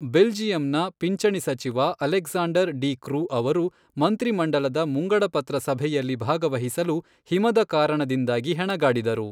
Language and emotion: Kannada, neutral